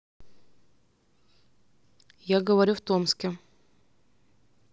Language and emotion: Russian, neutral